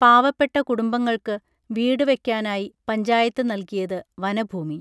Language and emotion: Malayalam, neutral